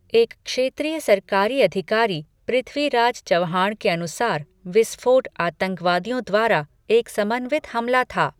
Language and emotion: Hindi, neutral